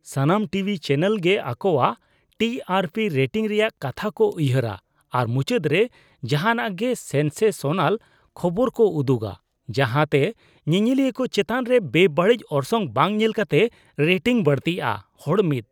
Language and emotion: Santali, disgusted